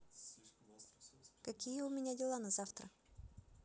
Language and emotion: Russian, positive